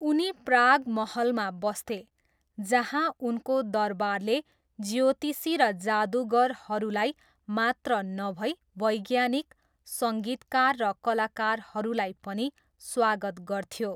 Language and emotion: Nepali, neutral